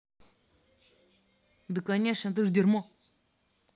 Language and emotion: Russian, angry